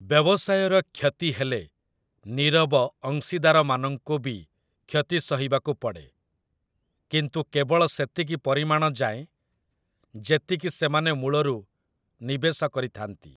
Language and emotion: Odia, neutral